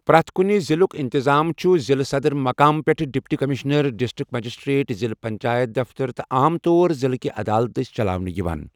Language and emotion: Kashmiri, neutral